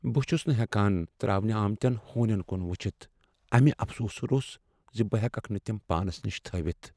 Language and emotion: Kashmiri, sad